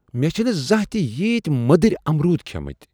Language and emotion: Kashmiri, surprised